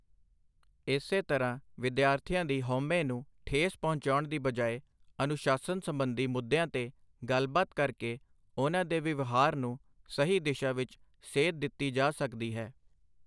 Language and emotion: Punjabi, neutral